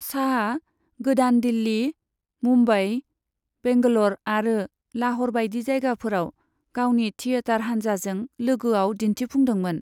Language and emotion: Bodo, neutral